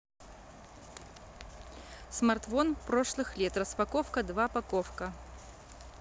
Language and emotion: Russian, neutral